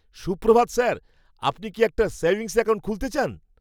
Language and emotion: Bengali, happy